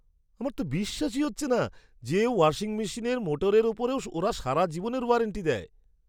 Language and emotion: Bengali, surprised